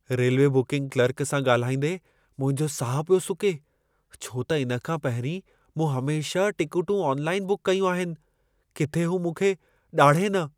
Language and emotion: Sindhi, fearful